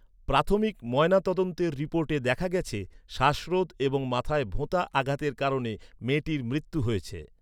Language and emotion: Bengali, neutral